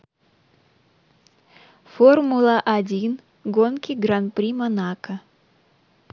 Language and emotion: Russian, neutral